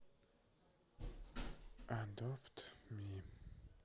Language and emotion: Russian, sad